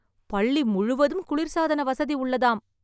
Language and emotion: Tamil, surprised